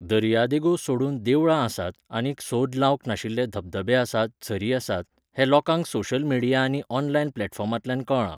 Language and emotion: Goan Konkani, neutral